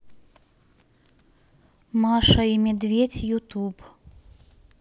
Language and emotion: Russian, neutral